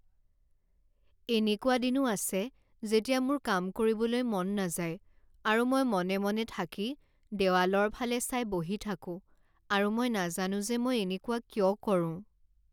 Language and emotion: Assamese, sad